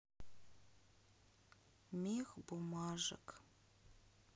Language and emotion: Russian, sad